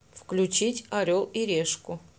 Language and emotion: Russian, neutral